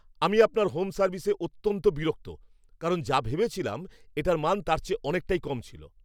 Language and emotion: Bengali, angry